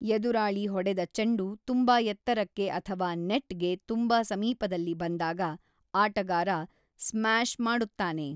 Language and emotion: Kannada, neutral